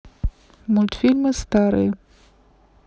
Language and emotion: Russian, neutral